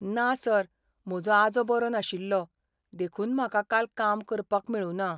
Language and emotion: Goan Konkani, sad